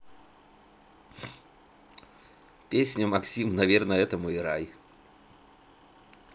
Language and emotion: Russian, neutral